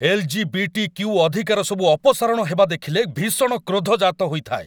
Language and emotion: Odia, angry